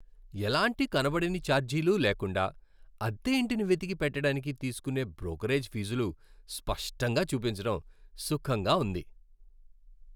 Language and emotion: Telugu, happy